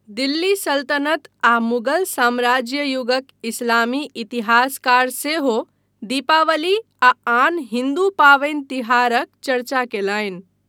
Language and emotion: Maithili, neutral